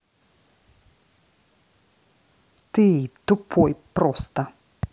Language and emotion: Russian, angry